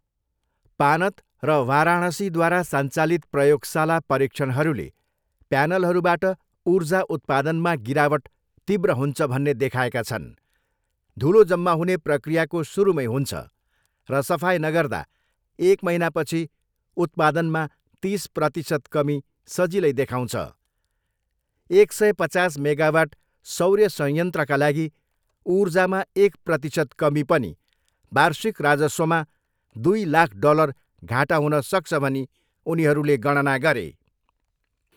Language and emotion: Nepali, neutral